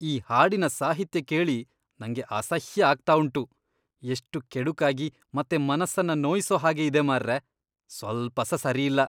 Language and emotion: Kannada, disgusted